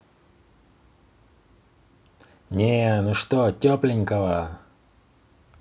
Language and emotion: Russian, neutral